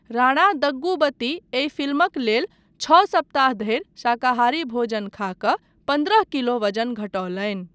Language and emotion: Maithili, neutral